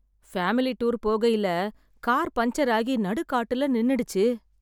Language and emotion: Tamil, sad